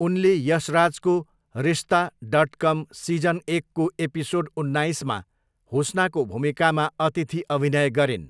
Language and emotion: Nepali, neutral